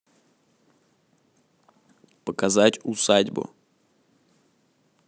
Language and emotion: Russian, neutral